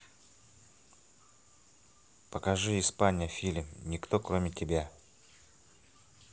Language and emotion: Russian, neutral